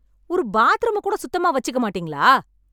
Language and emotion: Tamil, angry